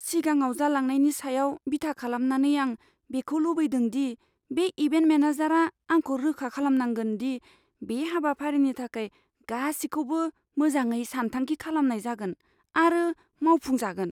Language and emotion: Bodo, fearful